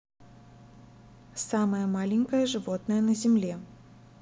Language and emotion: Russian, neutral